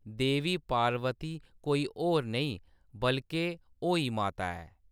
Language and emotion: Dogri, neutral